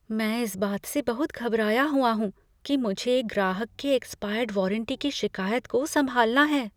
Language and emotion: Hindi, fearful